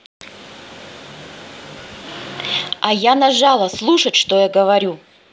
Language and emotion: Russian, angry